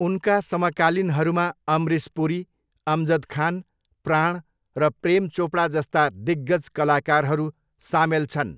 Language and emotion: Nepali, neutral